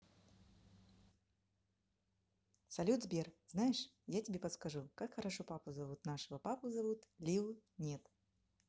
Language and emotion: Russian, positive